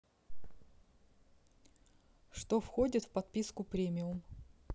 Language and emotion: Russian, neutral